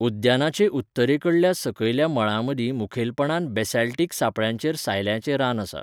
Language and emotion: Goan Konkani, neutral